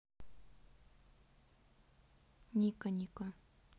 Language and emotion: Russian, neutral